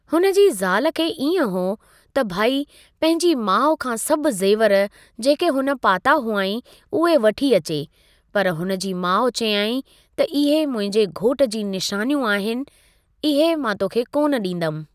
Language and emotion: Sindhi, neutral